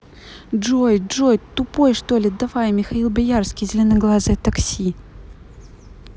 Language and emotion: Russian, angry